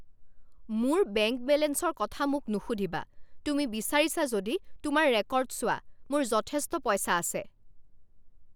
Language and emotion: Assamese, angry